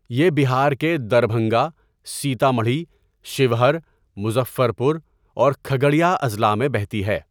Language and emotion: Urdu, neutral